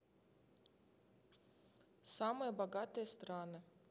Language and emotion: Russian, neutral